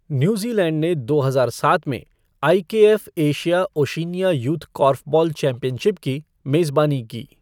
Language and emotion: Hindi, neutral